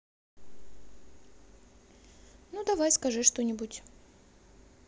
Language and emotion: Russian, neutral